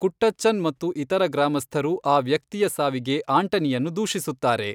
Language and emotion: Kannada, neutral